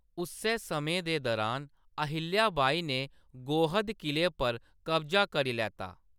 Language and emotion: Dogri, neutral